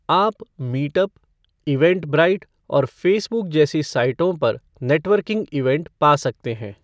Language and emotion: Hindi, neutral